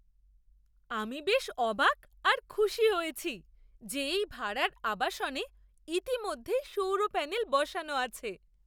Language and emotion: Bengali, surprised